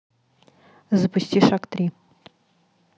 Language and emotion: Russian, neutral